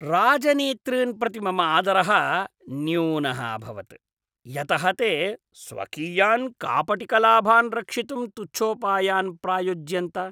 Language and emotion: Sanskrit, disgusted